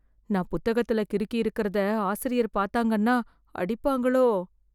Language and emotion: Tamil, fearful